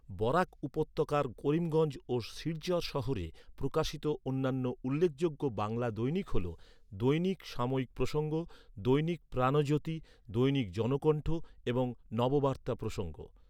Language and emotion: Bengali, neutral